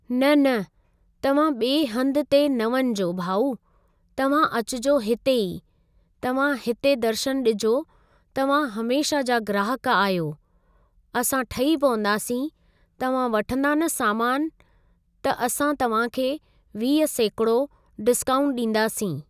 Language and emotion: Sindhi, neutral